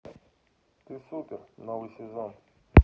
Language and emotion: Russian, neutral